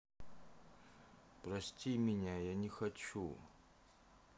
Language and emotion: Russian, sad